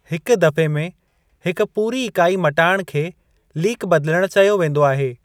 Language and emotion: Sindhi, neutral